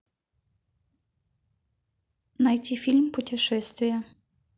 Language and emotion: Russian, neutral